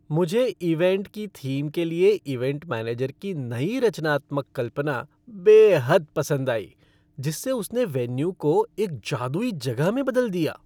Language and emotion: Hindi, happy